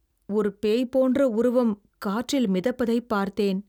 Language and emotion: Tamil, fearful